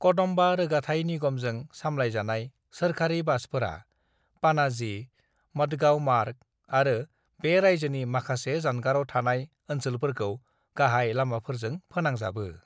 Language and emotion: Bodo, neutral